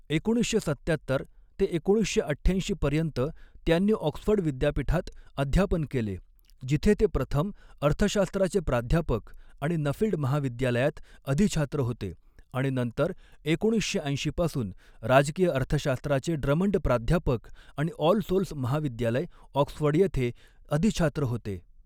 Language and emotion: Marathi, neutral